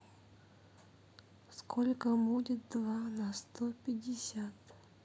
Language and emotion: Russian, sad